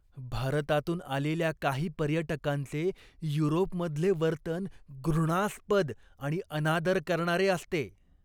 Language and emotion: Marathi, disgusted